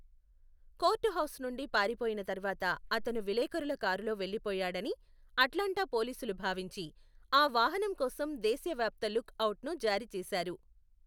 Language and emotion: Telugu, neutral